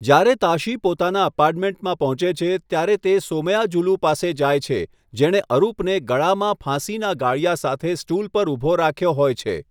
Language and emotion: Gujarati, neutral